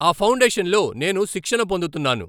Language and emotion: Telugu, neutral